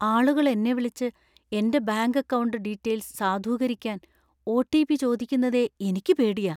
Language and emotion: Malayalam, fearful